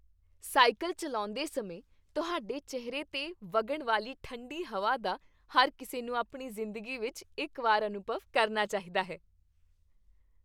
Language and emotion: Punjabi, happy